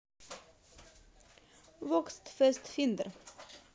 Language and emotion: Russian, positive